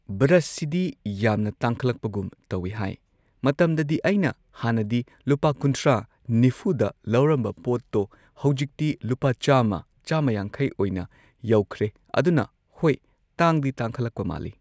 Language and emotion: Manipuri, neutral